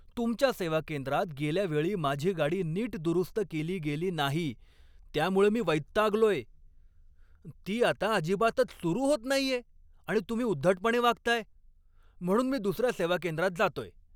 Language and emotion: Marathi, angry